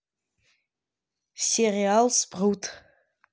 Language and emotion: Russian, neutral